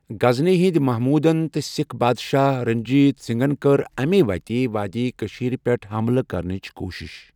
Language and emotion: Kashmiri, neutral